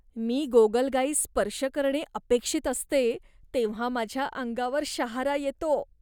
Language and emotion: Marathi, disgusted